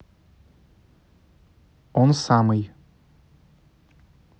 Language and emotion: Russian, neutral